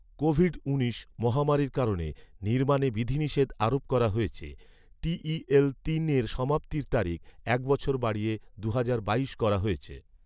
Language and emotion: Bengali, neutral